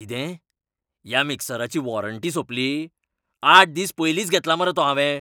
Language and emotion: Goan Konkani, angry